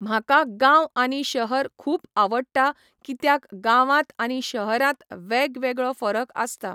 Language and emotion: Goan Konkani, neutral